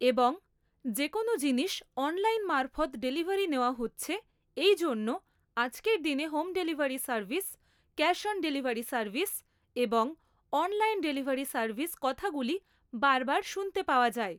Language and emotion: Bengali, neutral